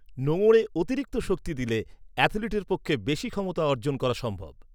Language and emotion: Bengali, neutral